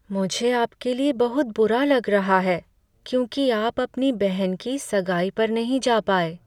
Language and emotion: Hindi, sad